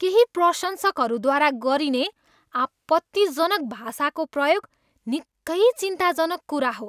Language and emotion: Nepali, disgusted